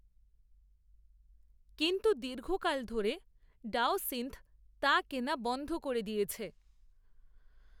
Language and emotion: Bengali, neutral